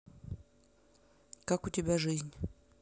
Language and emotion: Russian, neutral